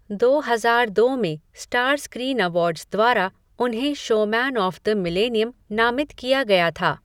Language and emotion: Hindi, neutral